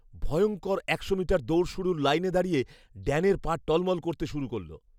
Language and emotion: Bengali, fearful